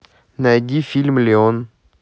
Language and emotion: Russian, neutral